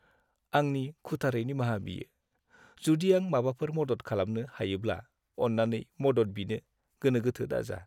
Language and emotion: Bodo, sad